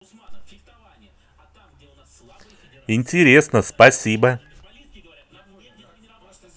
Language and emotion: Russian, positive